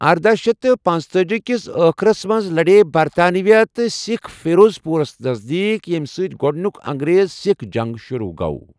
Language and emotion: Kashmiri, neutral